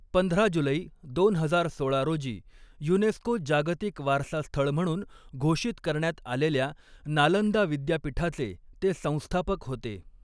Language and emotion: Marathi, neutral